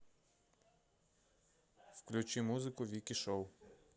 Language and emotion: Russian, neutral